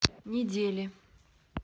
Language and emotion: Russian, neutral